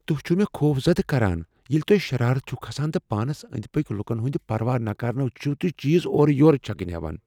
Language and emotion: Kashmiri, fearful